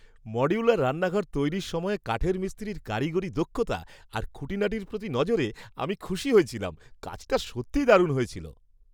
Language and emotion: Bengali, happy